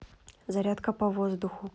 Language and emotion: Russian, neutral